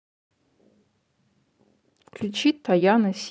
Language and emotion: Russian, neutral